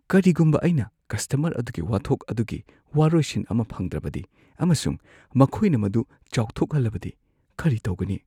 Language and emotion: Manipuri, fearful